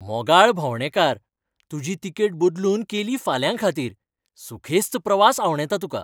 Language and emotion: Goan Konkani, happy